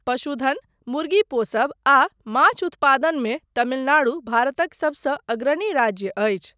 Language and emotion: Maithili, neutral